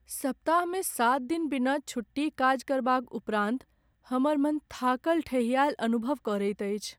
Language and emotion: Maithili, sad